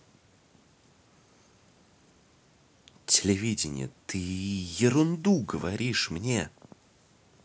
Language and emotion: Russian, angry